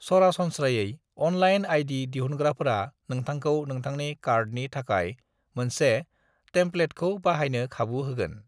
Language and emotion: Bodo, neutral